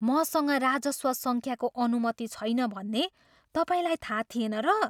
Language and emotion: Nepali, surprised